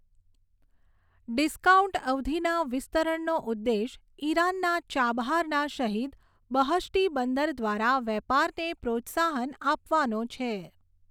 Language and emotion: Gujarati, neutral